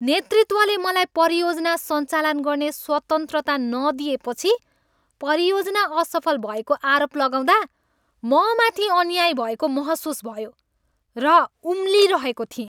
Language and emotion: Nepali, angry